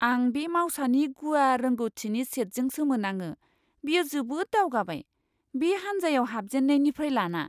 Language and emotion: Bodo, surprised